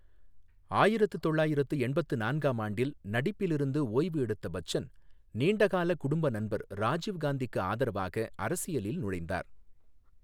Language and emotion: Tamil, neutral